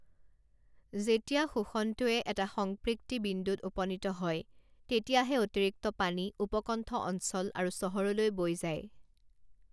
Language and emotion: Assamese, neutral